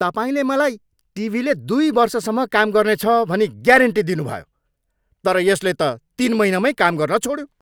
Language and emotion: Nepali, angry